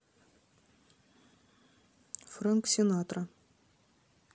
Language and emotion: Russian, neutral